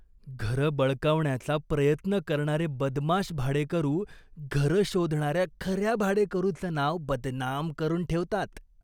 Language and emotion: Marathi, disgusted